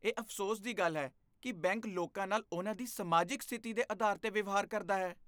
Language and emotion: Punjabi, disgusted